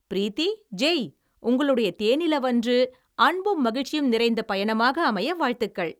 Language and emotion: Tamil, happy